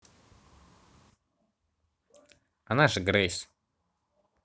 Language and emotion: Russian, neutral